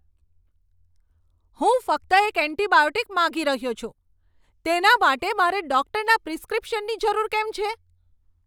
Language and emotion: Gujarati, angry